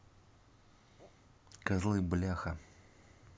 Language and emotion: Russian, neutral